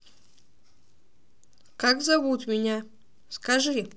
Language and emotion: Russian, positive